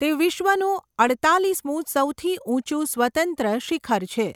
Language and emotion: Gujarati, neutral